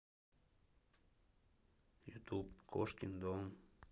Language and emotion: Russian, neutral